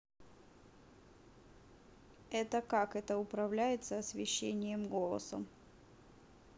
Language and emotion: Russian, neutral